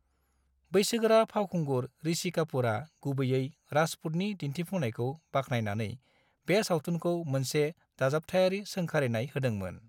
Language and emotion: Bodo, neutral